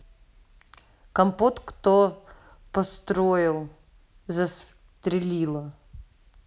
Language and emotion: Russian, neutral